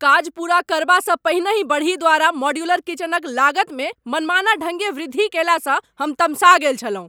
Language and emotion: Maithili, angry